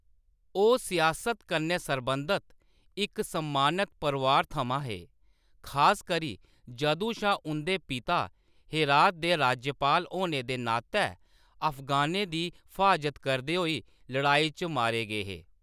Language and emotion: Dogri, neutral